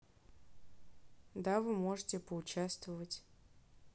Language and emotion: Russian, neutral